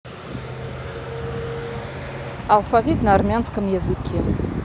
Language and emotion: Russian, neutral